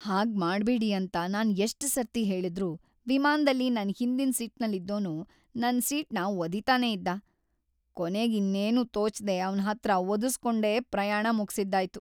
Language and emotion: Kannada, sad